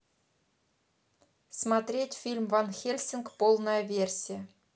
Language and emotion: Russian, neutral